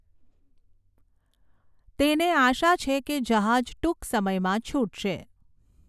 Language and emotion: Gujarati, neutral